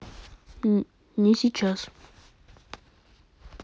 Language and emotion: Russian, neutral